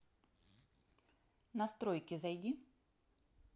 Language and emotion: Russian, neutral